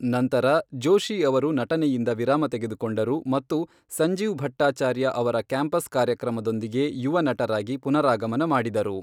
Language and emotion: Kannada, neutral